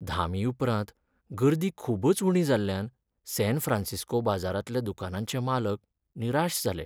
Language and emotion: Goan Konkani, sad